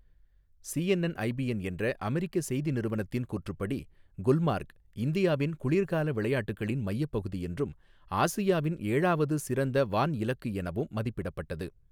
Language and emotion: Tamil, neutral